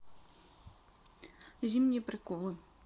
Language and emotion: Russian, neutral